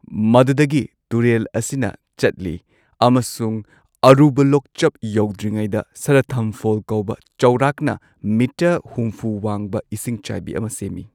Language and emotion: Manipuri, neutral